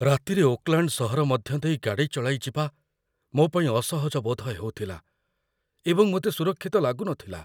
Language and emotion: Odia, fearful